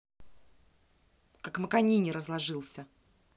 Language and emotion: Russian, angry